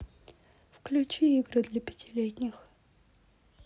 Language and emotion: Russian, neutral